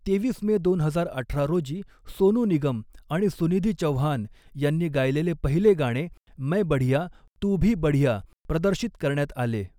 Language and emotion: Marathi, neutral